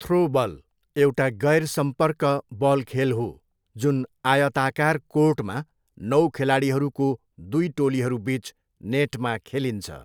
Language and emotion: Nepali, neutral